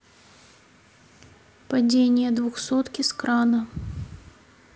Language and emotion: Russian, neutral